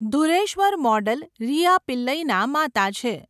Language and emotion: Gujarati, neutral